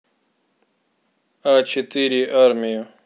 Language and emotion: Russian, neutral